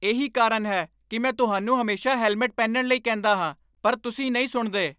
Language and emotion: Punjabi, angry